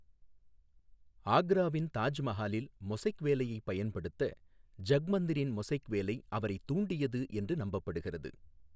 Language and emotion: Tamil, neutral